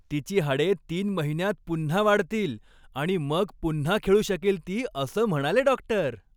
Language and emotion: Marathi, happy